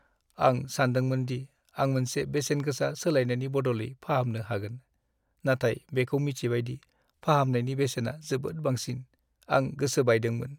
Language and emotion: Bodo, sad